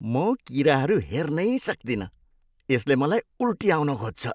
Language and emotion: Nepali, disgusted